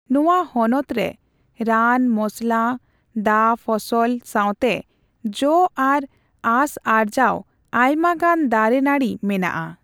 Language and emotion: Santali, neutral